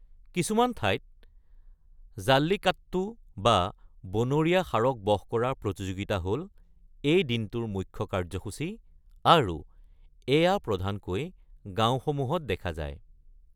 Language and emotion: Assamese, neutral